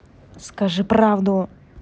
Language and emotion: Russian, angry